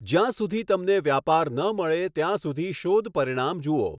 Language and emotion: Gujarati, neutral